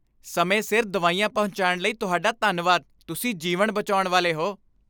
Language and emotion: Punjabi, happy